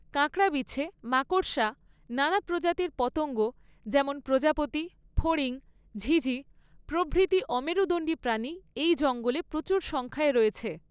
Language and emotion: Bengali, neutral